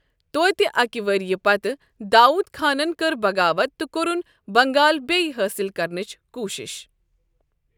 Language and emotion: Kashmiri, neutral